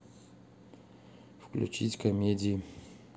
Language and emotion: Russian, neutral